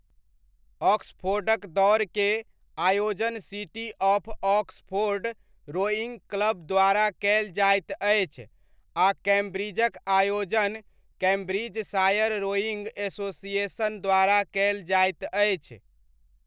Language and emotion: Maithili, neutral